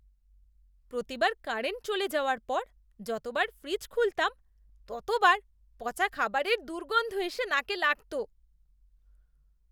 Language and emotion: Bengali, disgusted